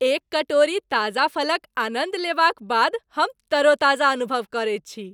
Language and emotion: Maithili, happy